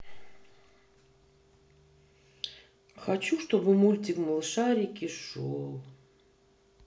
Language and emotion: Russian, sad